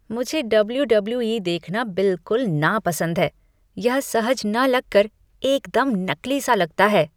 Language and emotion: Hindi, disgusted